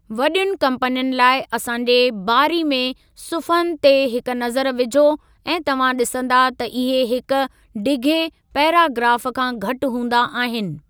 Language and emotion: Sindhi, neutral